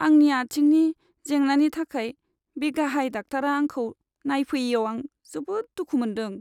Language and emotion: Bodo, sad